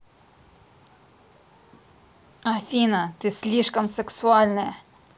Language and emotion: Russian, angry